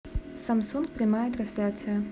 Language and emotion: Russian, neutral